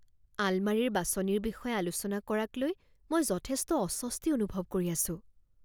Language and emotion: Assamese, fearful